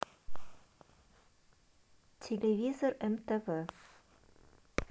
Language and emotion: Russian, neutral